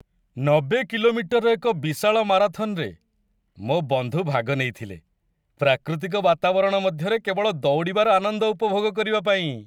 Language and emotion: Odia, happy